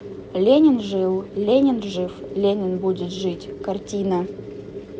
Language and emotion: Russian, neutral